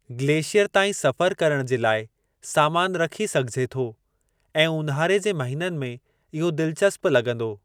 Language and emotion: Sindhi, neutral